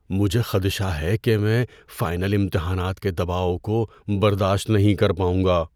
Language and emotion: Urdu, fearful